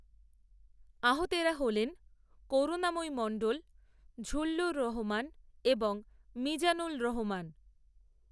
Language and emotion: Bengali, neutral